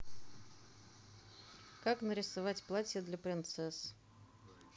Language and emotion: Russian, neutral